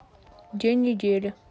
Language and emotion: Russian, neutral